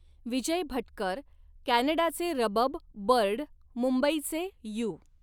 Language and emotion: Marathi, neutral